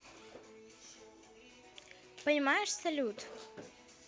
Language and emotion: Russian, neutral